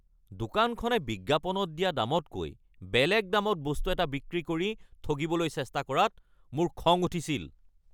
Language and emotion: Assamese, angry